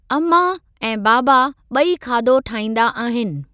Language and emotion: Sindhi, neutral